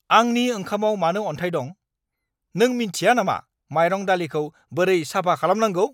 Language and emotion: Bodo, angry